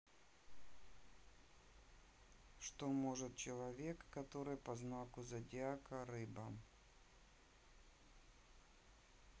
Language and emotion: Russian, neutral